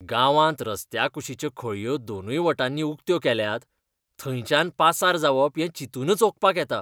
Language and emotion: Goan Konkani, disgusted